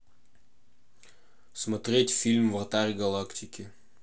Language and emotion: Russian, neutral